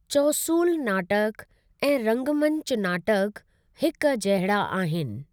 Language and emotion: Sindhi, neutral